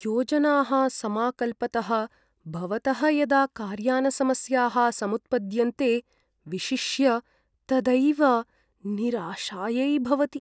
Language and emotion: Sanskrit, sad